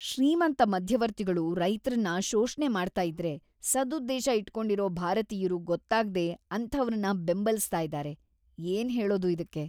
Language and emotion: Kannada, disgusted